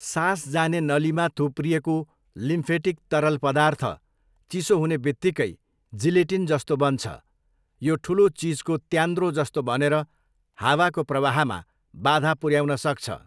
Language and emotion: Nepali, neutral